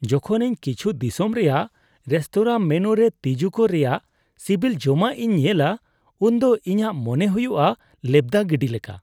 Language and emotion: Santali, disgusted